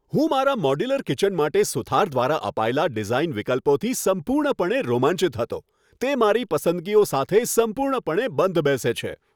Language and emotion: Gujarati, happy